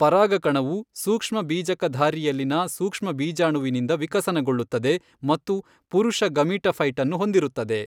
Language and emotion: Kannada, neutral